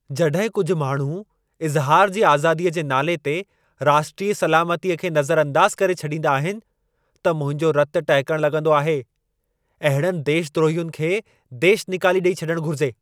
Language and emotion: Sindhi, angry